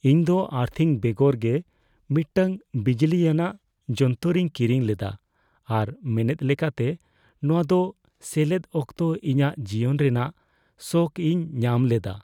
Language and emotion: Santali, fearful